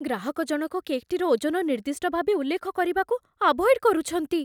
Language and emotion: Odia, fearful